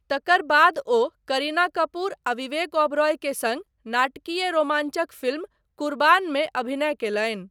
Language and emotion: Maithili, neutral